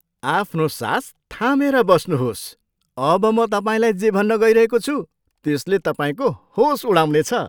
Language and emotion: Nepali, surprised